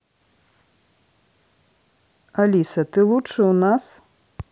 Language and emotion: Russian, neutral